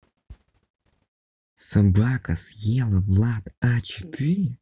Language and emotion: Russian, neutral